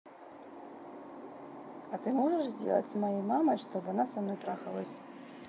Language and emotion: Russian, neutral